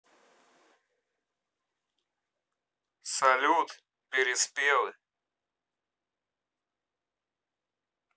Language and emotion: Russian, neutral